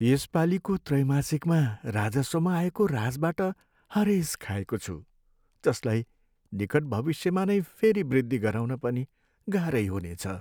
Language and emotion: Nepali, sad